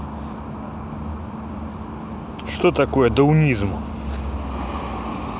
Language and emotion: Russian, neutral